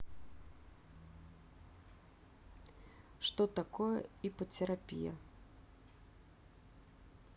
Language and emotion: Russian, neutral